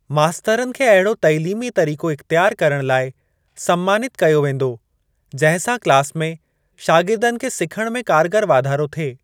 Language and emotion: Sindhi, neutral